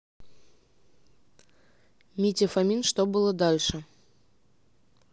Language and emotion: Russian, neutral